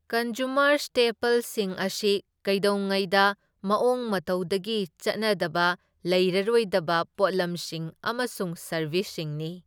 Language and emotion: Manipuri, neutral